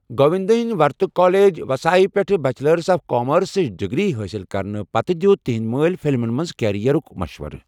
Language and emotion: Kashmiri, neutral